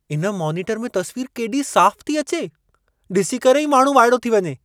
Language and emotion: Sindhi, surprised